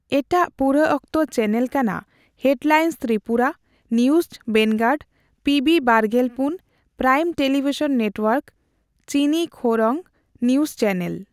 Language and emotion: Santali, neutral